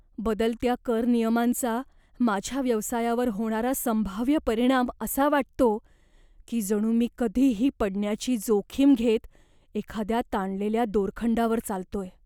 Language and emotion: Marathi, fearful